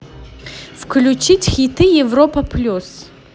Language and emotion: Russian, positive